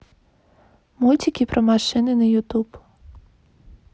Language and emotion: Russian, neutral